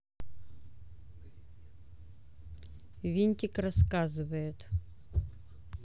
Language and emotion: Russian, neutral